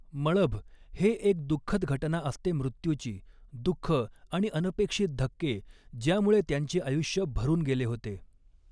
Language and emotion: Marathi, neutral